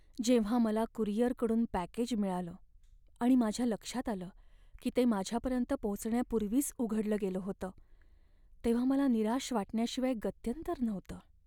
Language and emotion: Marathi, sad